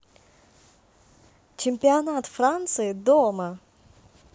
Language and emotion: Russian, positive